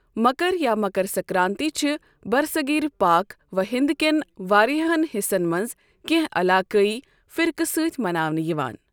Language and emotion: Kashmiri, neutral